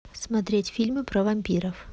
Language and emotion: Russian, neutral